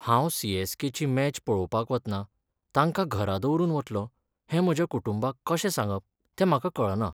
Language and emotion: Goan Konkani, sad